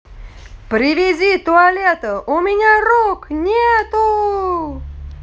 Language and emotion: Russian, positive